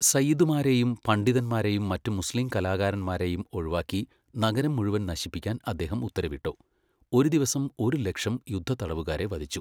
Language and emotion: Malayalam, neutral